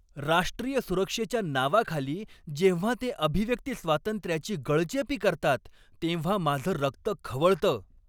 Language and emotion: Marathi, angry